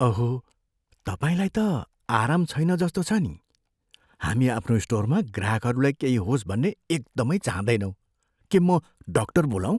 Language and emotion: Nepali, fearful